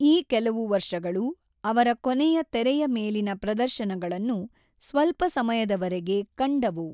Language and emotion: Kannada, neutral